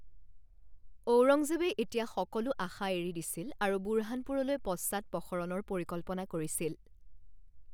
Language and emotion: Assamese, neutral